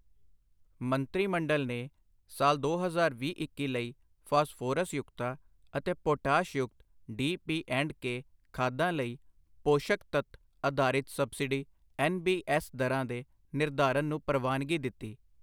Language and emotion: Punjabi, neutral